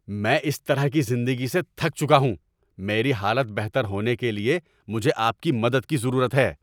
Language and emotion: Urdu, angry